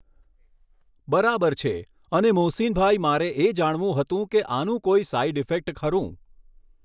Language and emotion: Gujarati, neutral